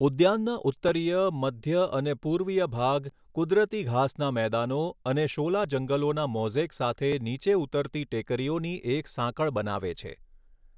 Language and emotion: Gujarati, neutral